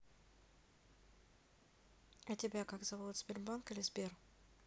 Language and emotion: Russian, neutral